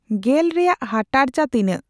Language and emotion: Santali, neutral